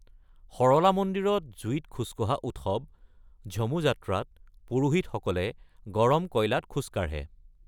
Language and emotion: Assamese, neutral